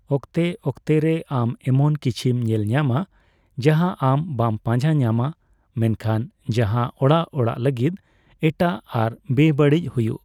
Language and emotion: Santali, neutral